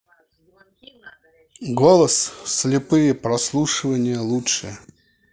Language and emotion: Russian, neutral